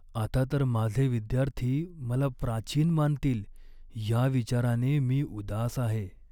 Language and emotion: Marathi, sad